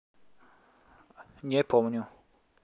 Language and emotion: Russian, neutral